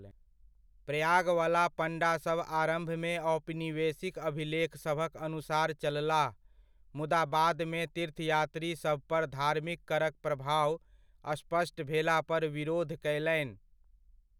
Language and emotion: Maithili, neutral